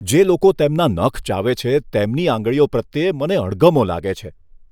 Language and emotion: Gujarati, disgusted